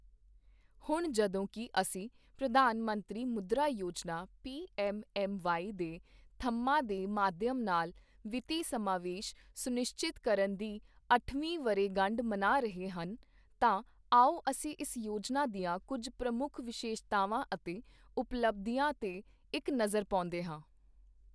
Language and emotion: Punjabi, neutral